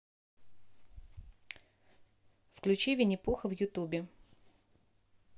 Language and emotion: Russian, neutral